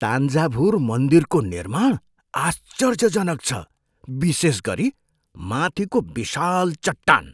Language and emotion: Nepali, surprised